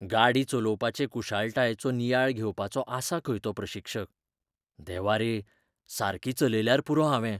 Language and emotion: Goan Konkani, fearful